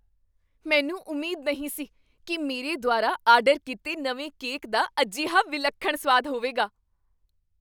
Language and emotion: Punjabi, surprised